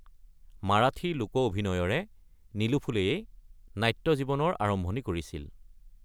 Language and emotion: Assamese, neutral